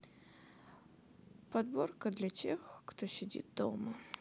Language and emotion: Russian, sad